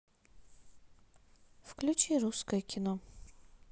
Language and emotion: Russian, neutral